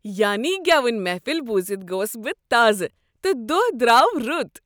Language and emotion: Kashmiri, happy